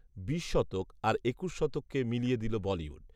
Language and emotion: Bengali, neutral